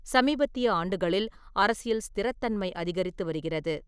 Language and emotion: Tamil, neutral